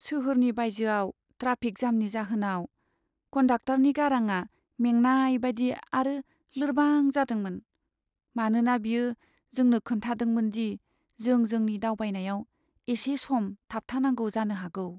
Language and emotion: Bodo, sad